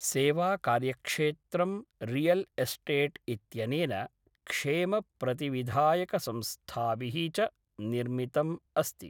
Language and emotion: Sanskrit, neutral